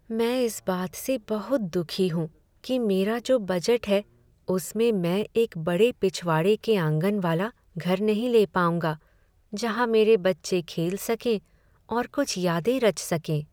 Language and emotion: Hindi, sad